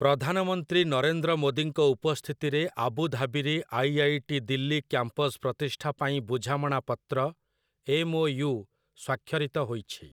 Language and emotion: Odia, neutral